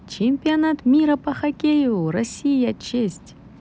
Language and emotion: Russian, positive